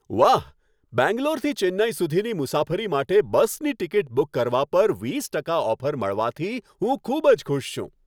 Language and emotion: Gujarati, happy